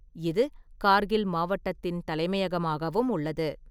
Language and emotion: Tamil, neutral